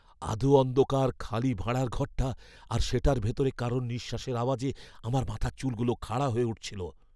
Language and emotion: Bengali, fearful